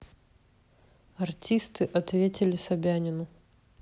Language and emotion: Russian, neutral